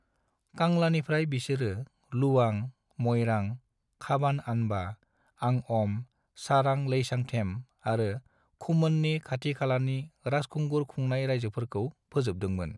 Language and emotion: Bodo, neutral